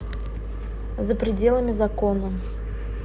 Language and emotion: Russian, neutral